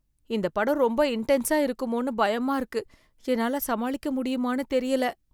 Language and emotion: Tamil, fearful